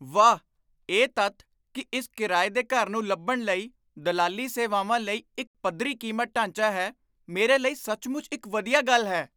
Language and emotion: Punjabi, surprised